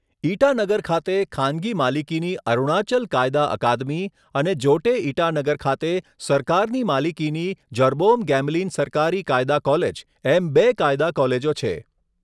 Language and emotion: Gujarati, neutral